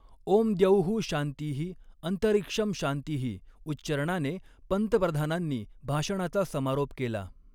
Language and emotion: Marathi, neutral